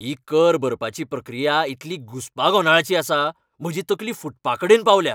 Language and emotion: Goan Konkani, angry